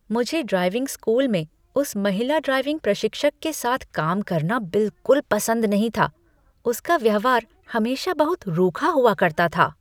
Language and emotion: Hindi, disgusted